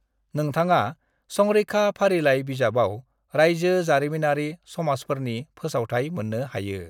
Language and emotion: Bodo, neutral